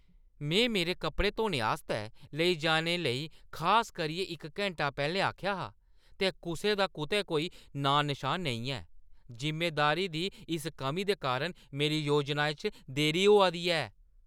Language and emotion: Dogri, angry